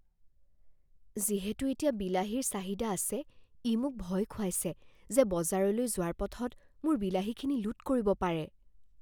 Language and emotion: Assamese, fearful